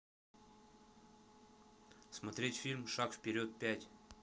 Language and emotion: Russian, neutral